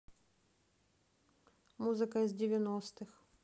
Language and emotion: Russian, neutral